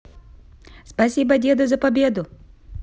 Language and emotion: Russian, positive